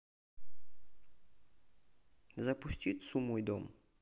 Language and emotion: Russian, neutral